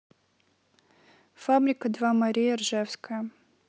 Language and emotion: Russian, neutral